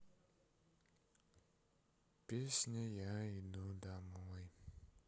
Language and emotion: Russian, sad